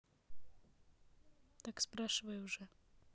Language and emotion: Russian, neutral